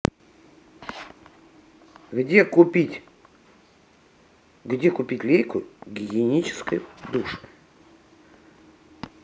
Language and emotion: Russian, neutral